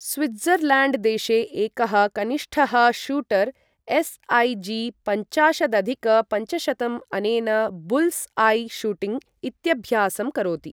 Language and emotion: Sanskrit, neutral